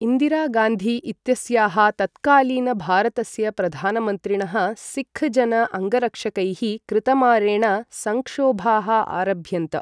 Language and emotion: Sanskrit, neutral